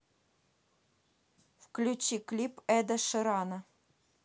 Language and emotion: Russian, neutral